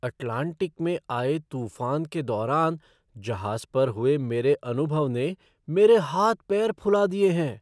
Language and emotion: Hindi, surprised